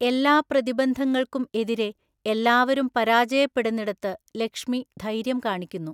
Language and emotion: Malayalam, neutral